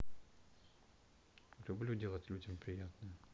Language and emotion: Russian, neutral